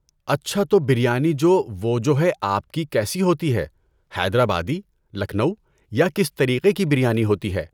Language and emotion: Urdu, neutral